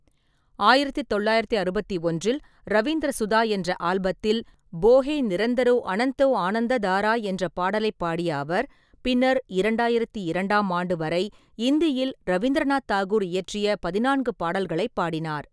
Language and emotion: Tamil, neutral